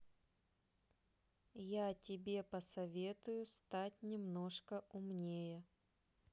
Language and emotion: Russian, neutral